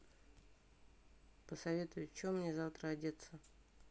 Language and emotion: Russian, neutral